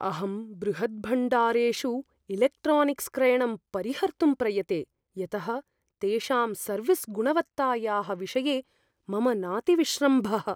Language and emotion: Sanskrit, fearful